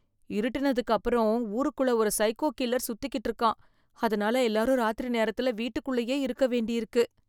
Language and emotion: Tamil, fearful